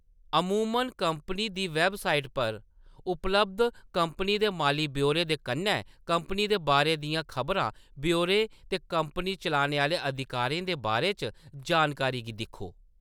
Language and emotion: Dogri, neutral